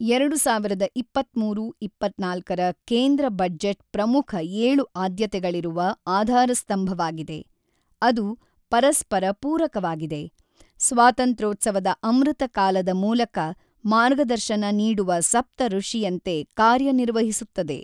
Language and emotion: Kannada, neutral